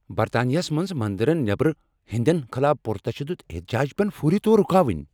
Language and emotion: Kashmiri, angry